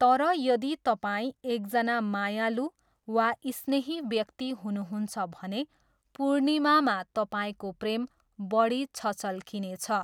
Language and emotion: Nepali, neutral